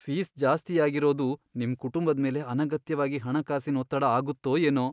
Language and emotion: Kannada, fearful